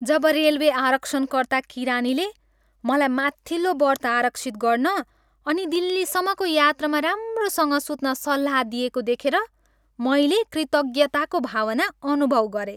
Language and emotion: Nepali, happy